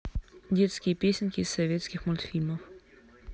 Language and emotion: Russian, neutral